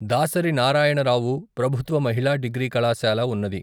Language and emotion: Telugu, neutral